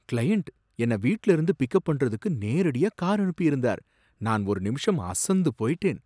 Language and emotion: Tamil, surprised